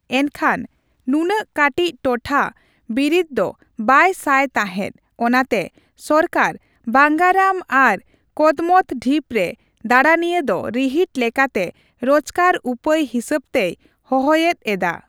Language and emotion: Santali, neutral